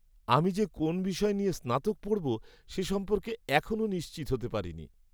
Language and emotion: Bengali, sad